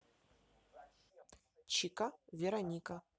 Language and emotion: Russian, neutral